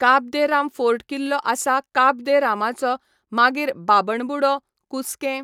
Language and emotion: Goan Konkani, neutral